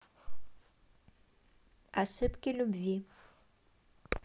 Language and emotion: Russian, neutral